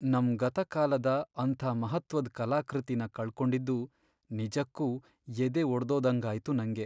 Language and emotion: Kannada, sad